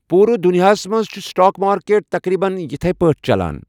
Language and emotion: Kashmiri, neutral